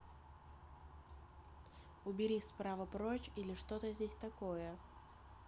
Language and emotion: Russian, neutral